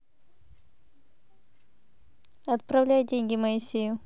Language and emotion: Russian, neutral